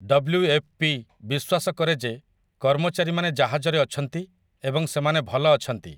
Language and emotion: Odia, neutral